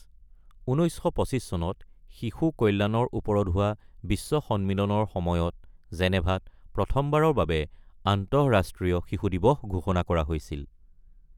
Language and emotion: Assamese, neutral